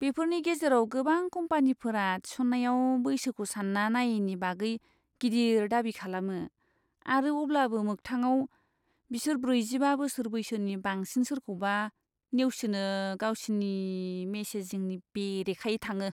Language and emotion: Bodo, disgusted